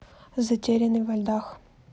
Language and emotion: Russian, neutral